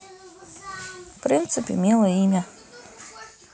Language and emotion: Russian, neutral